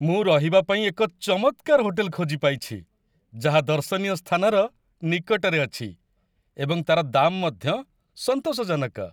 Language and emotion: Odia, happy